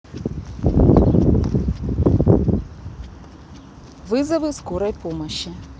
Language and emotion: Russian, neutral